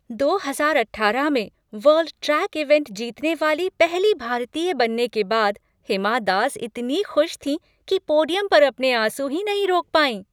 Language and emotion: Hindi, happy